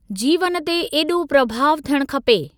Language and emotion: Sindhi, neutral